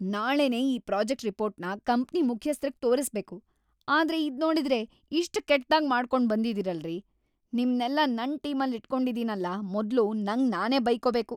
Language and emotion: Kannada, angry